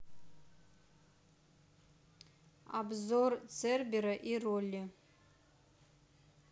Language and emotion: Russian, neutral